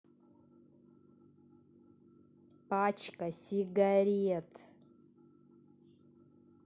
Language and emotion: Russian, angry